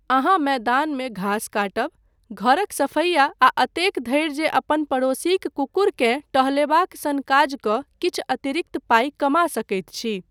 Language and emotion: Maithili, neutral